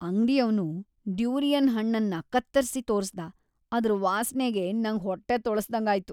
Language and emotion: Kannada, disgusted